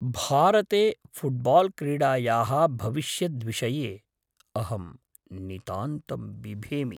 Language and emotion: Sanskrit, fearful